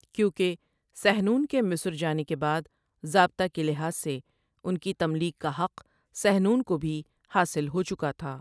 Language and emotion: Urdu, neutral